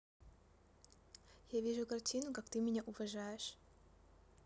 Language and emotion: Russian, neutral